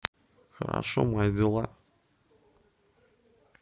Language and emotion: Russian, neutral